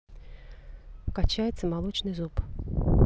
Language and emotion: Russian, neutral